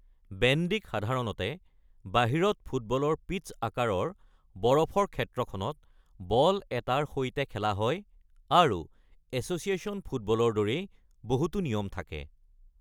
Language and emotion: Assamese, neutral